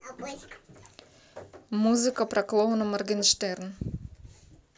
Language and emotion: Russian, neutral